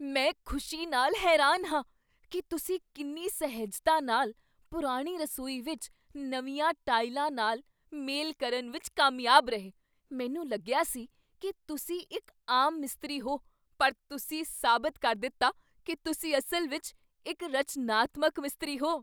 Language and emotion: Punjabi, surprised